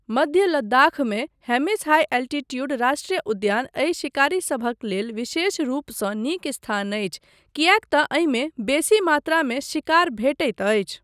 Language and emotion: Maithili, neutral